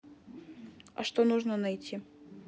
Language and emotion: Russian, neutral